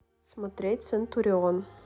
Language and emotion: Russian, neutral